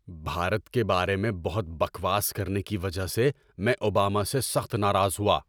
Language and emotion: Urdu, angry